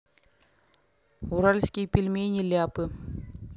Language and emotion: Russian, neutral